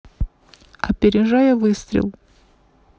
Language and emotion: Russian, neutral